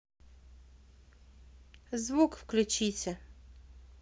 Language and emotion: Russian, neutral